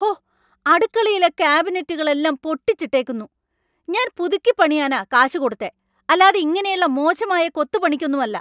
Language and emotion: Malayalam, angry